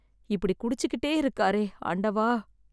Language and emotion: Tamil, sad